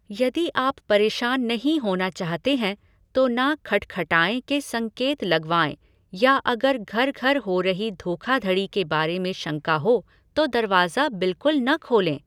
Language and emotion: Hindi, neutral